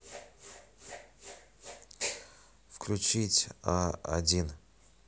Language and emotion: Russian, neutral